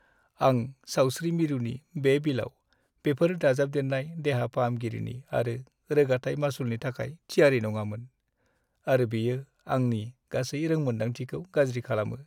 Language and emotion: Bodo, sad